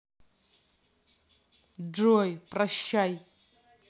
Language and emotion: Russian, angry